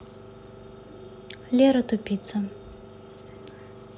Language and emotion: Russian, neutral